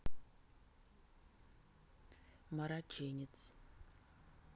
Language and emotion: Russian, neutral